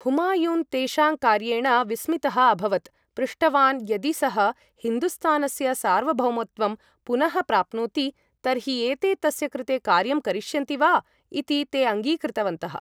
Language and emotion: Sanskrit, neutral